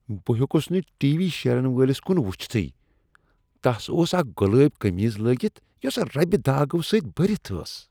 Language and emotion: Kashmiri, disgusted